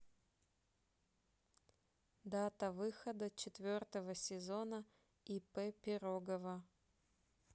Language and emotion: Russian, neutral